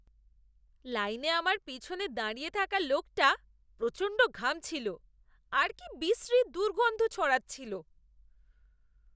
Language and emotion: Bengali, disgusted